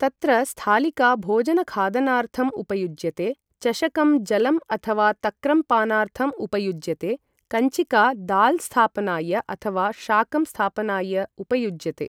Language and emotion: Sanskrit, neutral